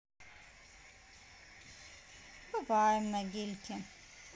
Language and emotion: Russian, sad